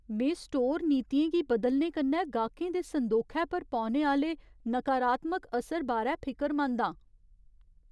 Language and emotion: Dogri, fearful